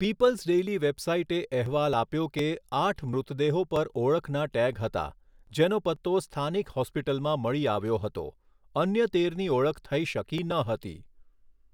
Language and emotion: Gujarati, neutral